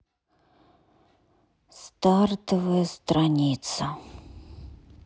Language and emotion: Russian, sad